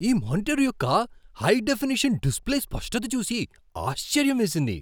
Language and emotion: Telugu, surprised